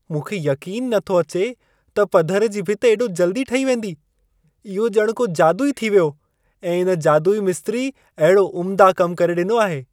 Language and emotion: Sindhi, surprised